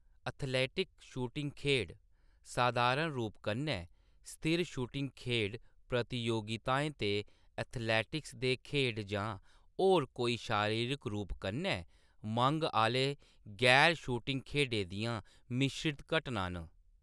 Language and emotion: Dogri, neutral